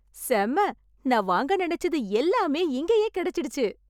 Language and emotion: Tamil, happy